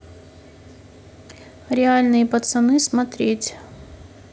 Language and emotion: Russian, neutral